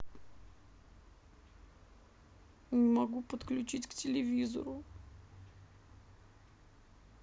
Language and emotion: Russian, sad